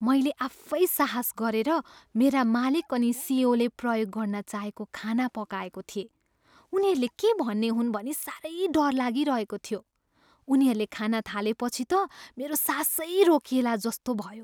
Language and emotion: Nepali, fearful